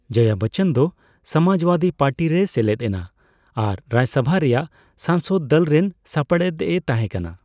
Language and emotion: Santali, neutral